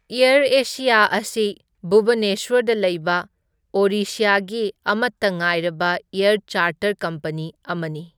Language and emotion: Manipuri, neutral